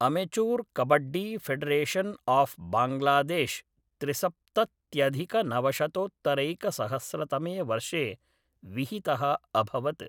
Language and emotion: Sanskrit, neutral